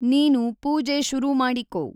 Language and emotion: Kannada, neutral